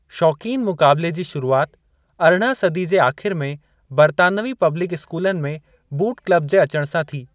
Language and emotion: Sindhi, neutral